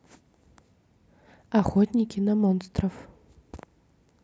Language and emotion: Russian, neutral